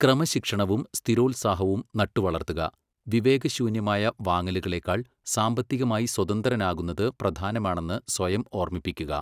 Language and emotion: Malayalam, neutral